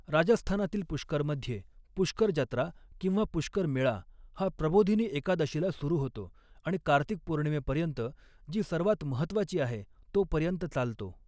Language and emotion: Marathi, neutral